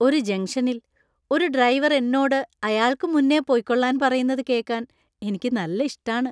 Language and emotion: Malayalam, happy